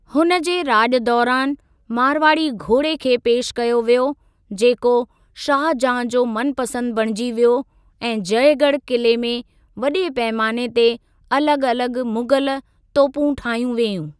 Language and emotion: Sindhi, neutral